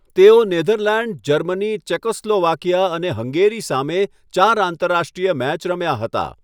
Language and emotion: Gujarati, neutral